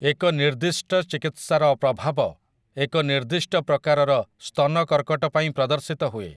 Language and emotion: Odia, neutral